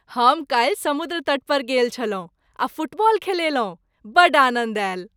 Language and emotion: Maithili, happy